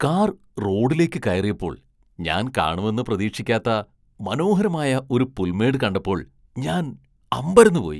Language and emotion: Malayalam, surprised